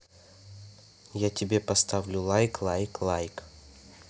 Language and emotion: Russian, neutral